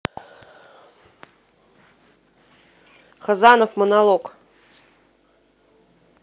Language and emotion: Russian, neutral